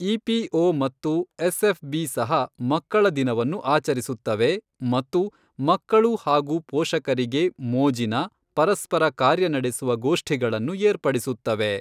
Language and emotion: Kannada, neutral